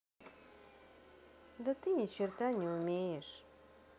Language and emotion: Russian, sad